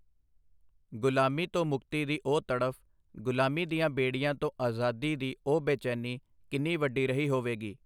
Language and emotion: Punjabi, neutral